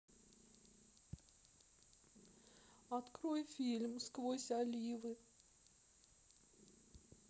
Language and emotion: Russian, sad